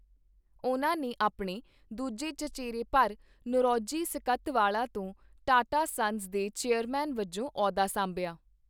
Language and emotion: Punjabi, neutral